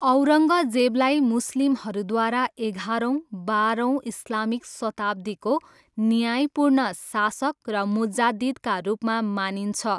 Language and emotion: Nepali, neutral